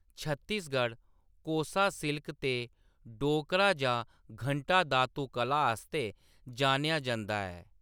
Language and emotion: Dogri, neutral